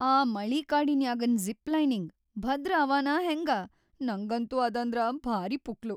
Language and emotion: Kannada, fearful